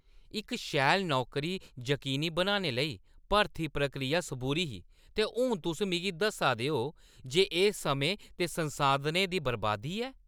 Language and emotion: Dogri, angry